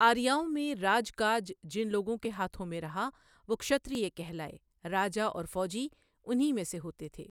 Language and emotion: Urdu, neutral